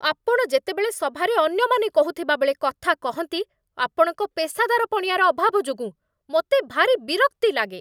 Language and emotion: Odia, angry